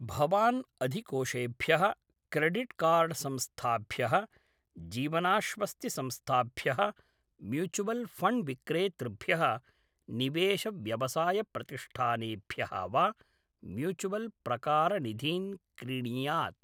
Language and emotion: Sanskrit, neutral